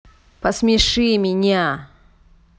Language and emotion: Russian, angry